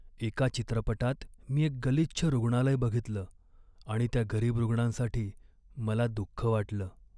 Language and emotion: Marathi, sad